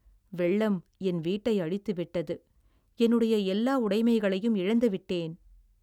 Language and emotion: Tamil, sad